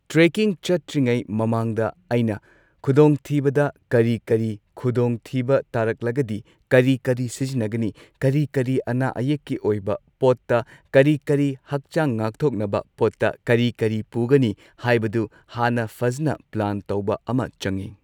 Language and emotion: Manipuri, neutral